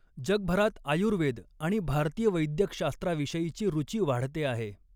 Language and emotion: Marathi, neutral